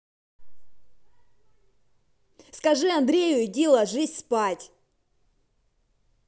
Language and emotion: Russian, angry